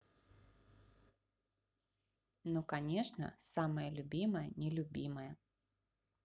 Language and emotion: Russian, positive